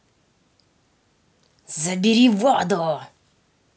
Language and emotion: Russian, angry